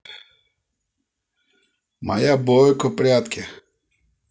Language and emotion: Russian, neutral